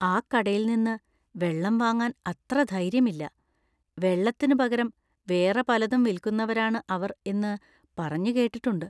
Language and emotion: Malayalam, fearful